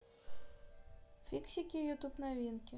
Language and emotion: Russian, neutral